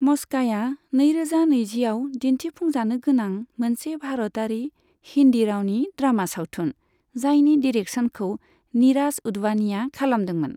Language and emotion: Bodo, neutral